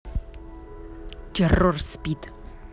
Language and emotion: Russian, angry